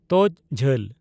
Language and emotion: Santali, neutral